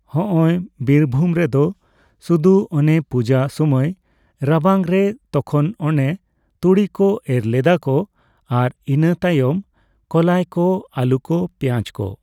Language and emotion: Santali, neutral